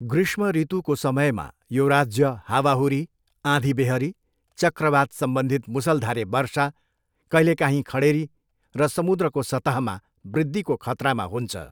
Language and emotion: Nepali, neutral